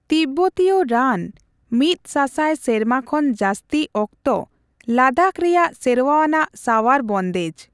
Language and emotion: Santali, neutral